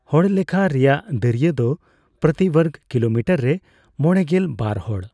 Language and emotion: Santali, neutral